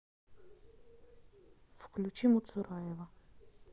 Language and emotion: Russian, neutral